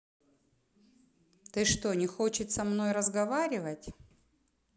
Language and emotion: Russian, angry